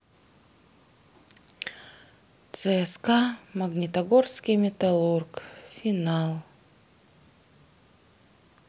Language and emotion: Russian, sad